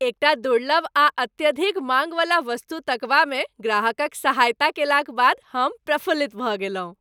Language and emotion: Maithili, happy